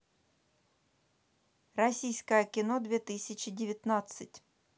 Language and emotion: Russian, neutral